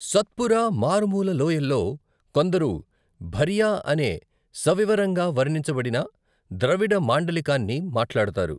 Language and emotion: Telugu, neutral